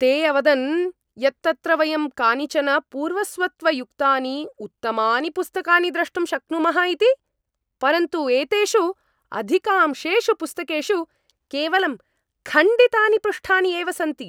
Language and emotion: Sanskrit, angry